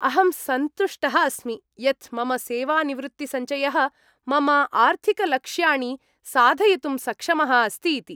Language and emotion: Sanskrit, happy